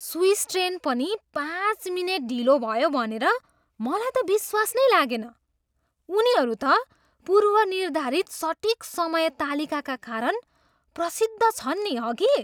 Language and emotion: Nepali, surprised